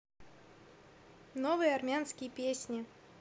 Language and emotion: Russian, neutral